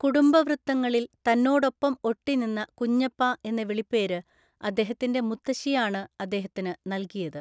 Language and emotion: Malayalam, neutral